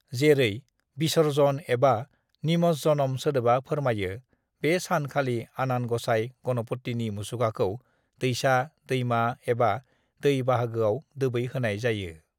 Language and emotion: Bodo, neutral